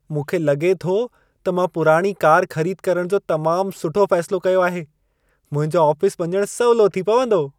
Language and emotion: Sindhi, happy